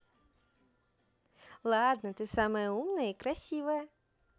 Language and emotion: Russian, positive